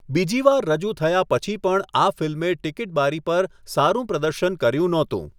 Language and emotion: Gujarati, neutral